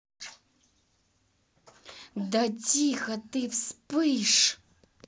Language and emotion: Russian, angry